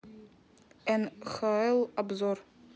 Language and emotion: Russian, neutral